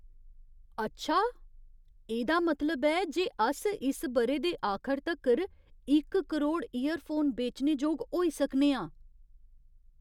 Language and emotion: Dogri, surprised